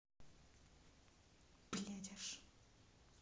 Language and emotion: Russian, angry